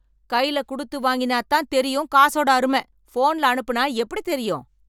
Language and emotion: Tamil, angry